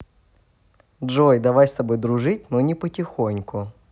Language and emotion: Russian, positive